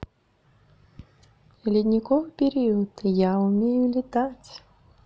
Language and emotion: Russian, positive